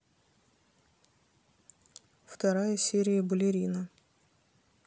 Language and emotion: Russian, neutral